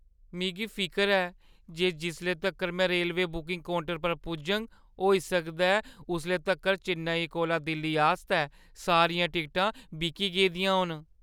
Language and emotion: Dogri, fearful